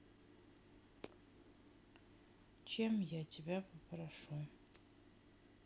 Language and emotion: Russian, sad